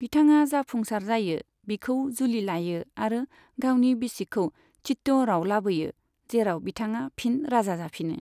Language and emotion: Bodo, neutral